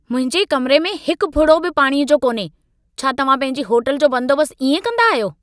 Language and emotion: Sindhi, angry